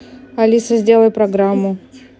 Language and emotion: Russian, neutral